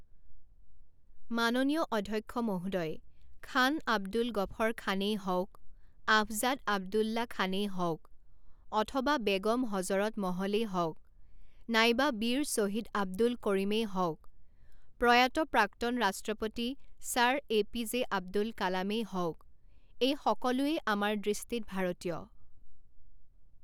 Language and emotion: Assamese, neutral